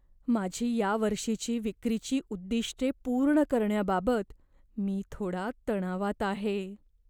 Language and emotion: Marathi, fearful